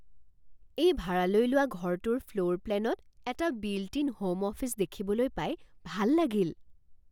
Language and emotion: Assamese, surprised